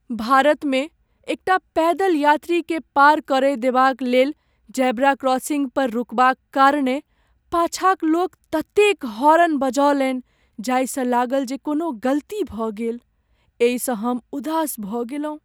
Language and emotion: Maithili, sad